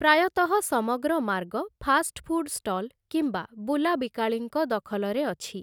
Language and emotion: Odia, neutral